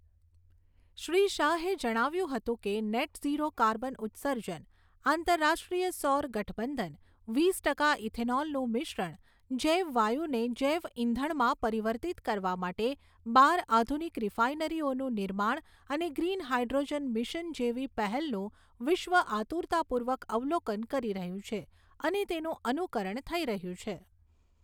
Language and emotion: Gujarati, neutral